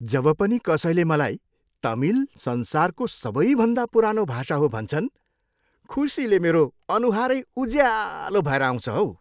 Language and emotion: Nepali, happy